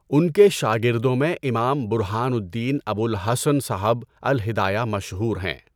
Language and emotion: Urdu, neutral